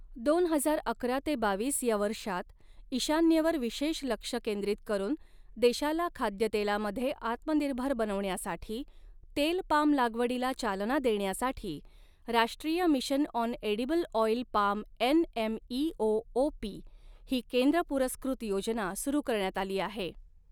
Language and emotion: Marathi, neutral